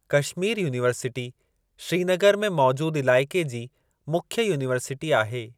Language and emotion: Sindhi, neutral